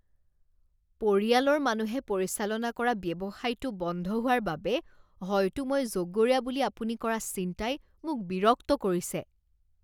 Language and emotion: Assamese, disgusted